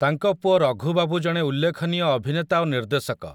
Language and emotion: Odia, neutral